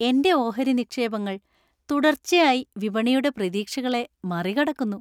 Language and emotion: Malayalam, happy